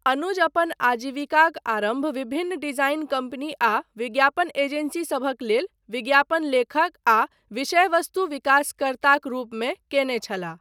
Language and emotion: Maithili, neutral